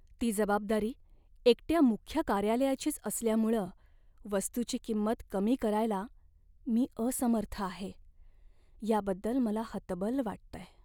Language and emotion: Marathi, sad